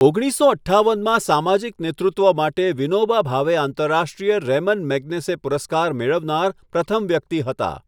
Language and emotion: Gujarati, neutral